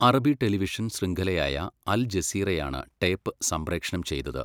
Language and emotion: Malayalam, neutral